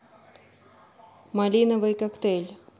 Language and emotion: Russian, neutral